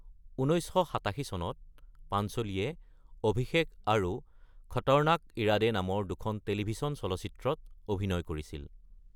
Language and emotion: Assamese, neutral